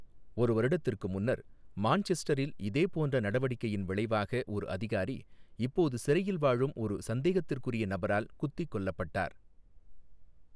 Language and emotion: Tamil, neutral